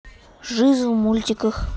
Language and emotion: Russian, neutral